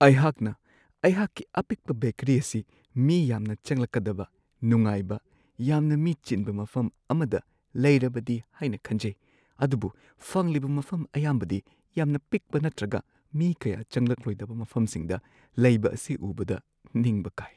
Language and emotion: Manipuri, sad